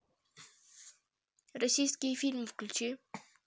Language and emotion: Russian, neutral